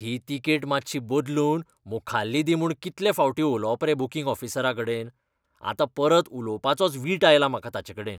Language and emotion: Goan Konkani, disgusted